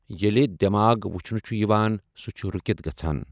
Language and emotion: Kashmiri, neutral